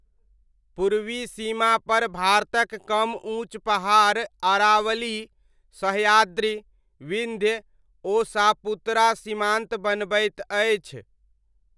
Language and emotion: Maithili, neutral